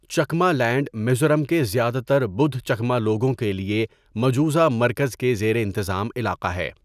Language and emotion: Urdu, neutral